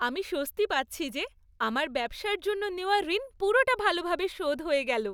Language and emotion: Bengali, happy